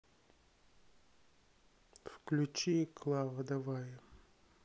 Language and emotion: Russian, sad